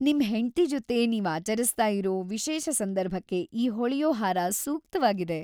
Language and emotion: Kannada, happy